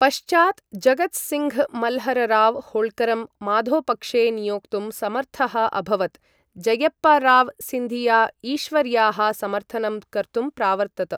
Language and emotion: Sanskrit, neutral